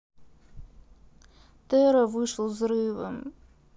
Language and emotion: Russian, sad